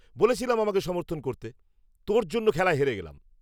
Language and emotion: Bengali, angry